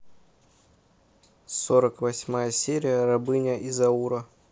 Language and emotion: Russian, neutral